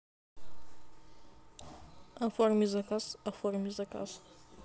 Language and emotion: Russian, neutral